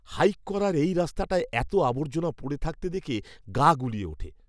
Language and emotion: Bengali, disgusted